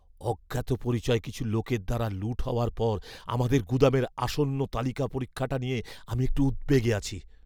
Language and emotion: Bengali, fearful